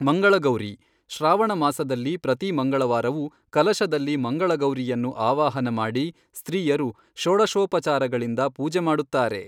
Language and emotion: Kannada, neutral